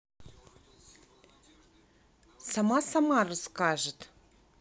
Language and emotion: Russian, neutral